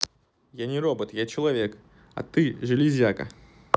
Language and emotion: Russian, neutral